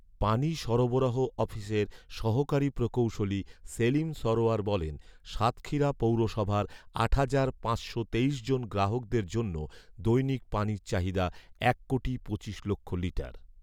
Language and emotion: Bengali, neutral